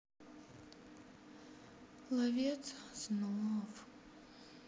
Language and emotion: Russian, sad